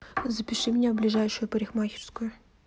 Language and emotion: Russian, neutral